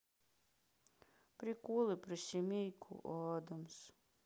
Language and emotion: Russian, sad